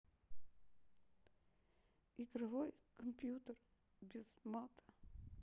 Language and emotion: Russian, sad